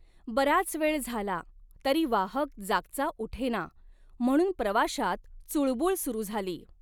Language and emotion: Marathi, neutral